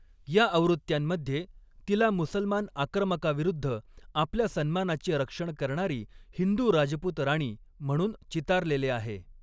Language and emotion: Marathi, neutral